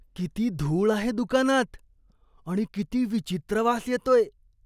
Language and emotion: Marathi, disgusted